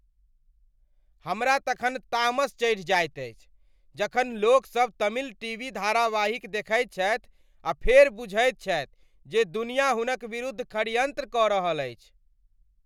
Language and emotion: Maithili, angry